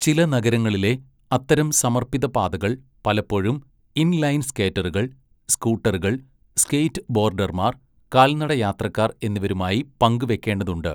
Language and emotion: Malayalam, neutral